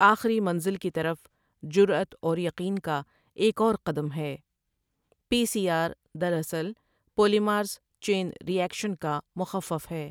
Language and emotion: Urdu, neutral